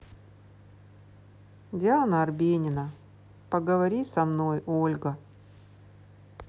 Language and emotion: Russian, neutral